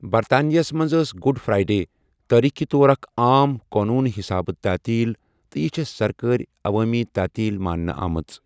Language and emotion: Kashmiri, neutral